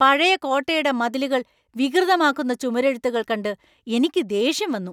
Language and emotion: Malayalam, angry